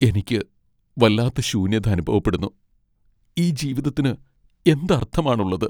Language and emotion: Malayalam, sad